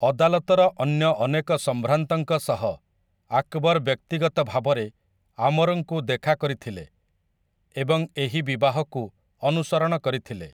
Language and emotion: Odia, neutral